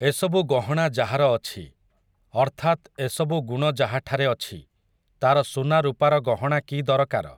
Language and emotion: Odia, neutral